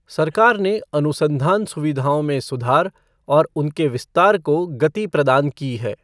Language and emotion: Hindi, neutral